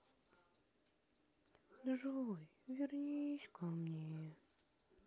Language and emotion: Russian, sad